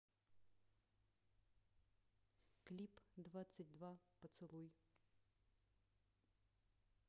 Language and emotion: Russian, neutral